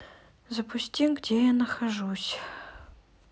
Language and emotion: Russian, sad